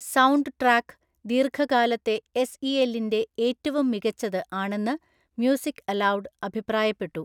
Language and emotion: Malayalam, neutral